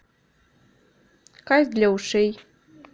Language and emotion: Russian, neutral